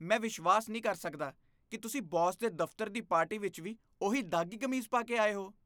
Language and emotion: Punjabi, disgusted